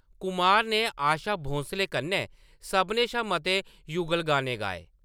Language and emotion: Dogri, neutral